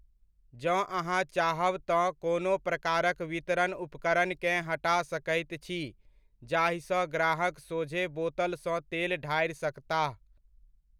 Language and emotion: Maithili, neutral